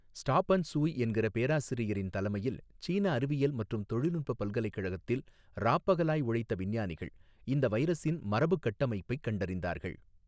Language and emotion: Tamil, neutral